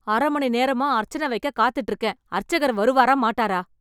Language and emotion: Tamil, angry